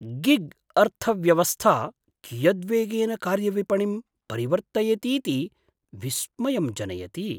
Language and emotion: Sanskrit, surprised